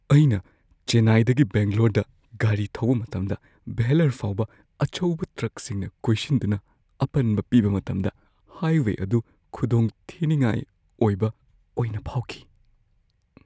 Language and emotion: Manipuri, fearful